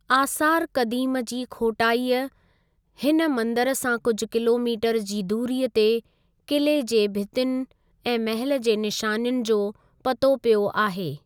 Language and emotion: Sindhi, neutral